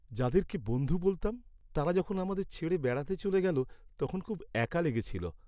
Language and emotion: Bengali, sad